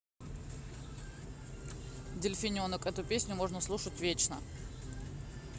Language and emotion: Russian, neutral